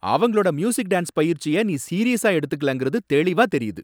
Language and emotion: Tamil, angry